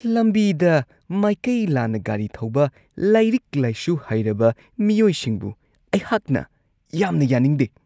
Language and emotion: Manipuri, disgusted